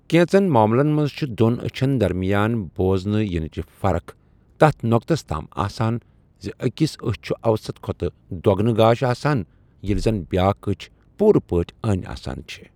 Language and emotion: Kashmiri, neutral